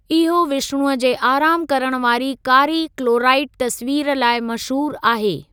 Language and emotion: Sindhi, neutral